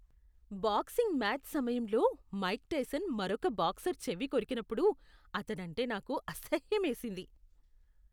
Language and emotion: Telugu, disgusted